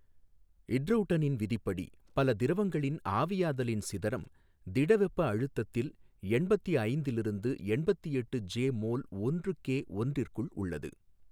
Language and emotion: Tamil, neutral